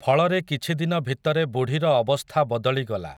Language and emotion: Odia, neutral